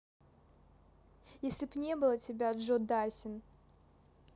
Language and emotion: Russian, neutral